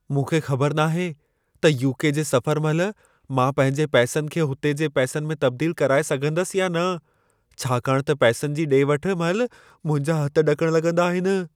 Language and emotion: Sindhi, fearful